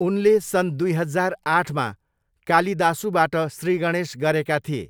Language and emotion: Nepali, neutral